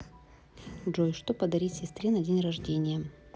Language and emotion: Russian, neutral